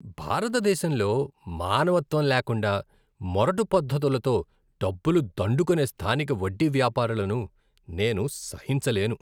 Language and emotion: Telugu, disgusted